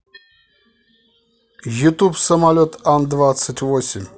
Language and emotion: Russian, neutral